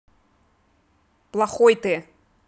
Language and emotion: Russian, angry